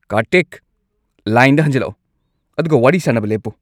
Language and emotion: Manipuri, angry